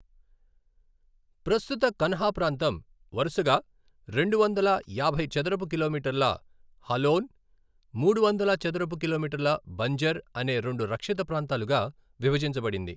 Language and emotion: Telugu, neutral